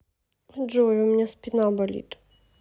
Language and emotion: Russian, sad